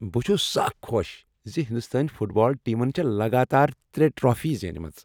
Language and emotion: Kashmiri, happy